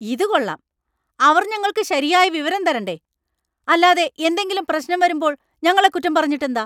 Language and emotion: Malayalam, angry